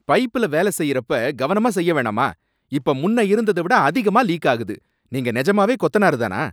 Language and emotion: Tamil, angry